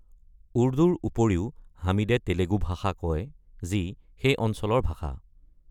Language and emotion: Assamese, neutral